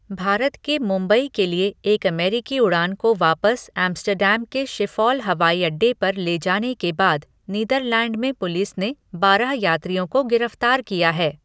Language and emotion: Hindi, neutral